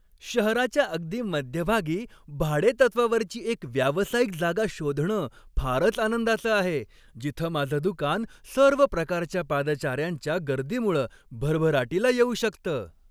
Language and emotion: Marathi, happy